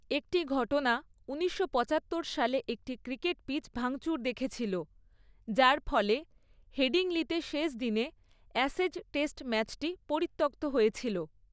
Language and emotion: Bengali, neutral